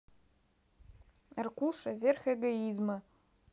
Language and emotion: Russian, neutral